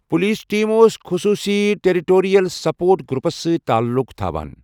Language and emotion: Kashmiri, neutral